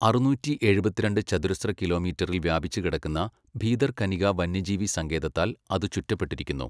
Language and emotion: Malayalam, neutral